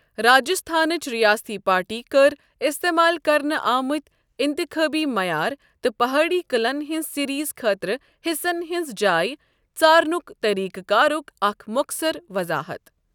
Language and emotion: Kashmiri, neutral